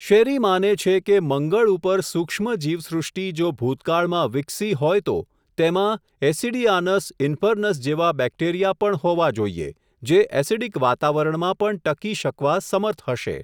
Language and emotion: Gujarati, neutral